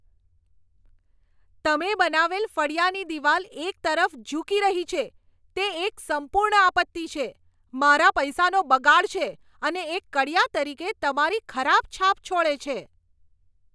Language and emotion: Gujarati, angry